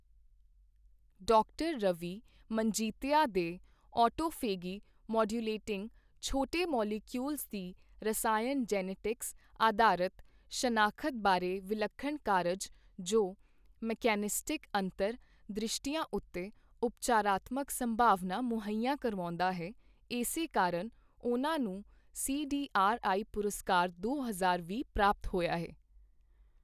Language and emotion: Punjabi, neutral